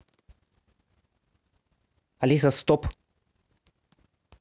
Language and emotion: Russian, neutral